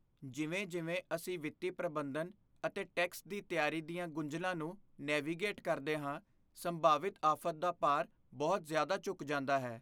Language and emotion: Punjabi, fearful